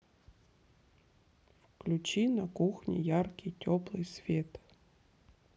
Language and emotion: Russian, neutral